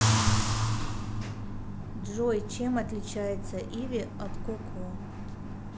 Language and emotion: Russian, neutral